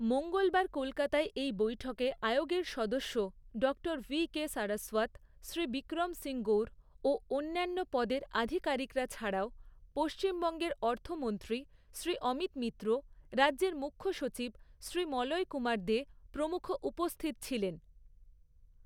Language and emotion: Bengali, neutral